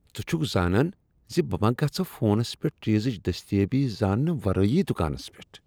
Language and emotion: Kashmiri, disgusted